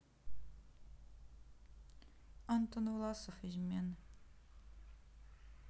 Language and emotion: Russian, neutral